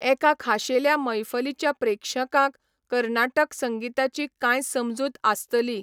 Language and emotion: Goan Konkani, neutral